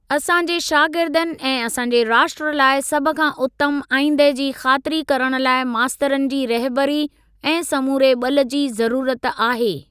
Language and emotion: Sindhi, neutral